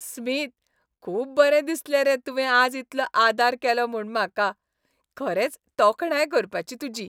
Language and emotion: Goan Konkani, happy